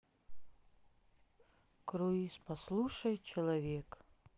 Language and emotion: Russian, sad